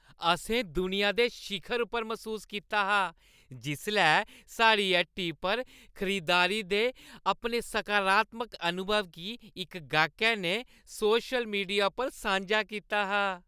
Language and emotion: Dogri, happy